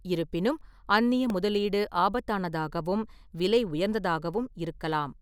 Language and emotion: Tamil, neutral